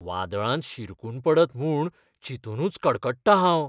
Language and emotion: Goan Konkani, fearful